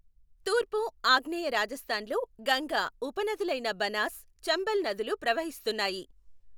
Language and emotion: Telugu, neutral